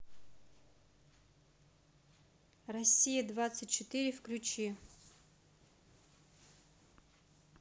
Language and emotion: Russian, neutral